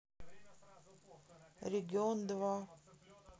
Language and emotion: Russian, neutral